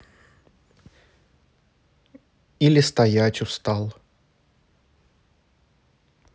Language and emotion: Russian, neutral